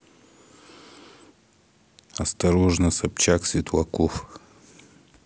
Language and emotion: Russian, neutral